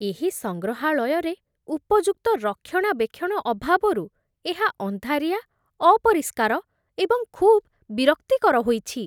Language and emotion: Odia, disgusted